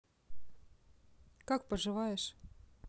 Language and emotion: Russian, neutral